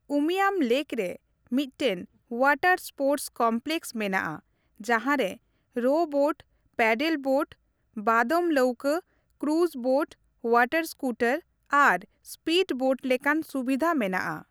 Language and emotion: Santali, neutral